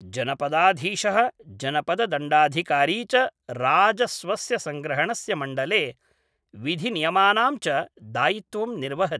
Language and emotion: Sanskrit, neutral